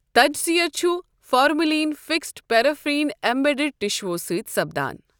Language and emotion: Kashmiri, neutral